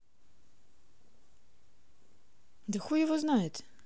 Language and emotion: Russian, neutral